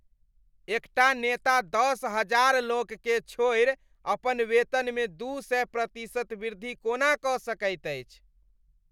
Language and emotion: Maithili, disgusted